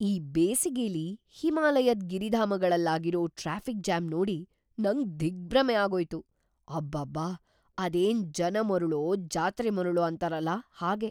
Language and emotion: Kannada, surprised